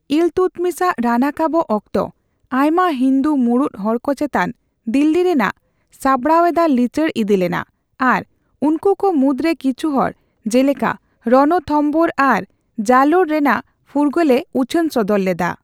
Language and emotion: Santali, neutral